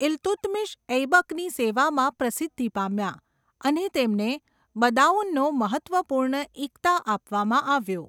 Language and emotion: Gujarati, neutral